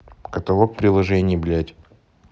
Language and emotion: Russian, neutral